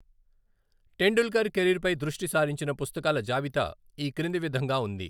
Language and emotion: Telugu, neutral